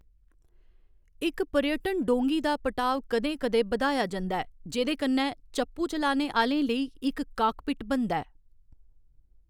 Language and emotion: Dogri, neutral